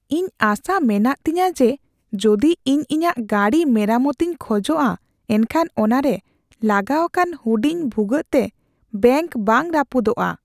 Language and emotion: Santali, fearful